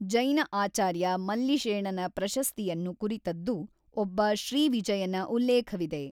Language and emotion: Kannada, neutral